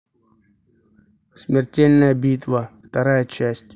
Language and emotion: Russian, neutral